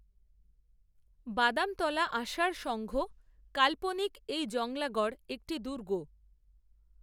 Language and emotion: Bengali, neutral